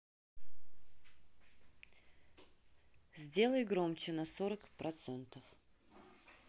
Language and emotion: Russian, neutral